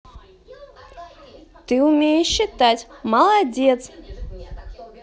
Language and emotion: Russian, positive